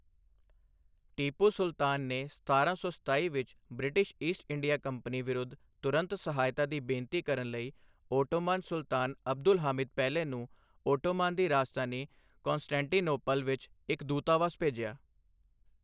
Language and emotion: Punjabi, neutral